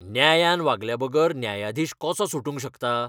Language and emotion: Goan Konkani, angry